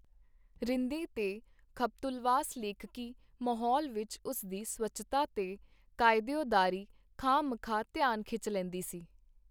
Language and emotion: Punjabi, neutral